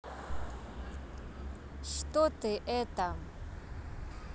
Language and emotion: Russian, neutral